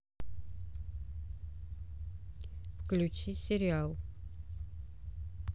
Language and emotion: Russian, neutral